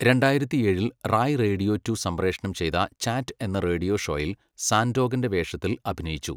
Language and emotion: Malayalam, neutral